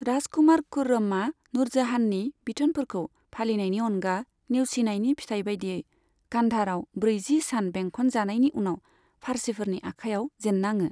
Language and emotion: Bodo, neutral